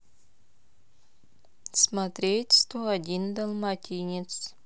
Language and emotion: Russian, neutral